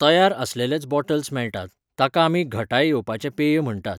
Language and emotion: Goan Konkani, neutral